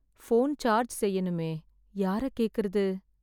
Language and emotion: Tamil, sad